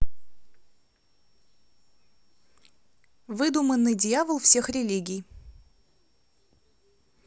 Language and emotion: Russian, neutral